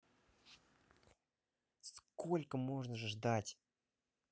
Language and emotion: Russian, angry